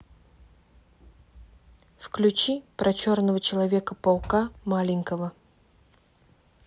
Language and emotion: Russian, neutral